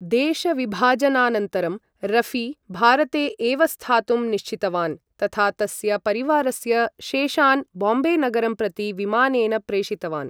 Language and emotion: Sanskrit, neutral